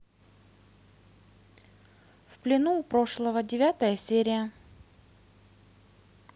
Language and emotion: Russian, neutral